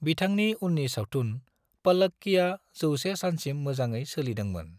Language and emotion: Bodo, neutral